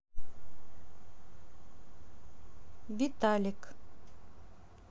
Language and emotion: Russian, neutral